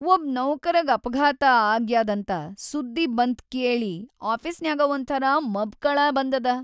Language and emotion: Kannada, sad